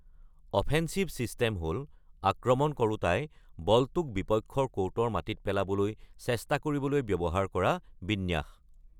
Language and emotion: Assamese, neutral